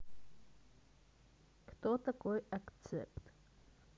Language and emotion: Russian, neutral